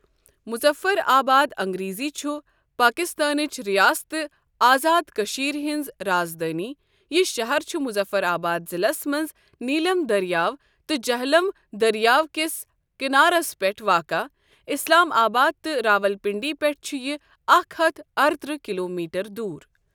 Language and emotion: Kashmiri, neutral